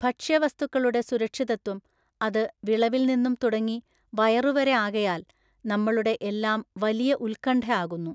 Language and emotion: Malayalam, neutral